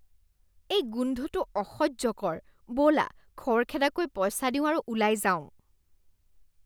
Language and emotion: Assamese, disgusted